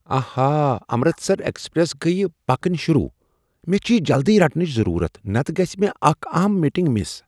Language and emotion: Kashmiri, surprised